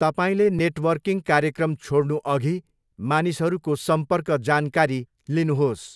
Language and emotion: Nepali, neutral